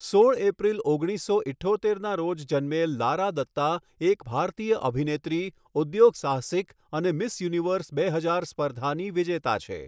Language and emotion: Gujarati, neutral